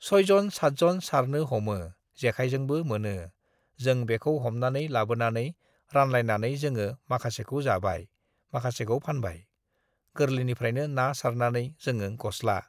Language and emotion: Bodo, neutral